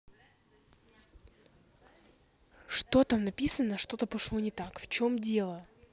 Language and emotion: Russian, angry